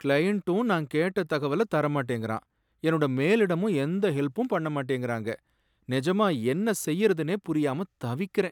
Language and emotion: Tamil, sad